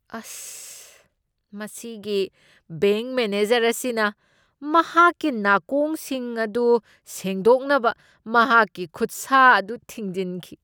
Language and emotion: Manipuri, disgusted